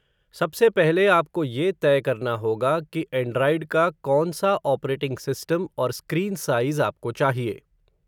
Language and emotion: Hindi, neutral